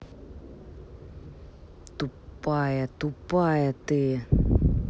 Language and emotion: Russian, angry